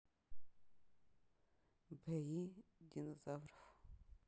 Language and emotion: Russian, neutral